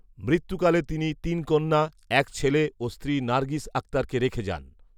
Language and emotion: Bengali, neutral